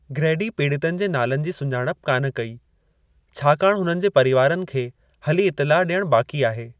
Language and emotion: Sindhi, neutral